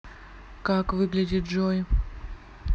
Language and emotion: Russian, neutral